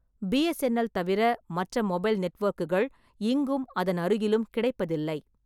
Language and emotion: Tamil, neutral